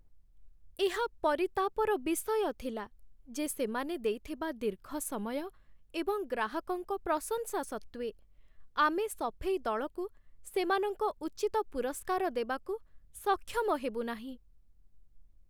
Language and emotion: Odia, sad